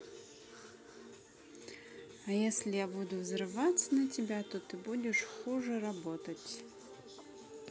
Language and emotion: Russian, neutral